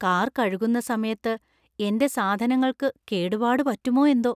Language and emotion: Malayalam, fearful